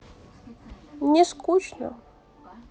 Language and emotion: Russian, sad